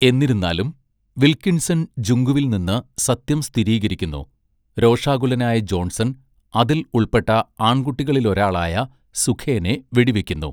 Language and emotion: Malayalam, neutral